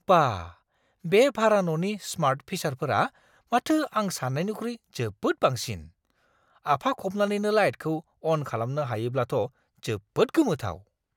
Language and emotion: Bodo, surprised